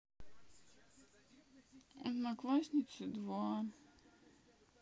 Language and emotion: Russian, sad